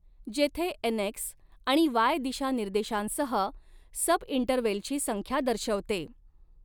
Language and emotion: Marathi, neutral